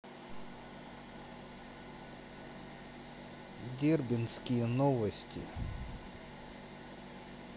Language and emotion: Russian, neutral